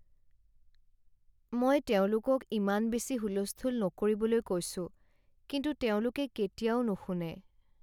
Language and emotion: Assamese, sad